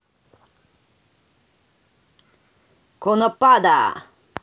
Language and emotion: Russian, neutral